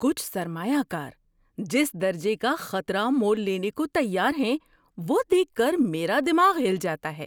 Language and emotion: Urdu, surprised